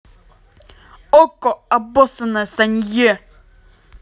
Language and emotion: Russian, angry